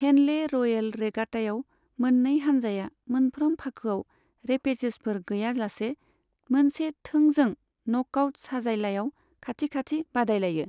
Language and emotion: Bodo, neutral